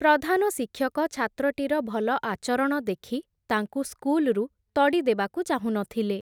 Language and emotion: Odia, neutral